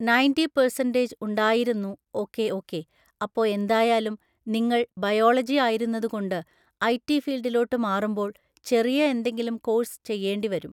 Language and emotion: Malayalam, neutral